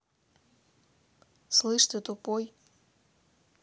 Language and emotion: Russian, neutral